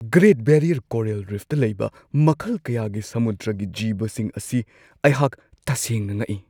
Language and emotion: Manipuri, surprised